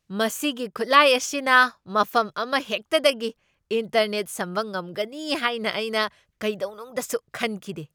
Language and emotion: Manipuri, surprised